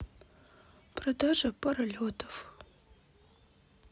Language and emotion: Russian, sad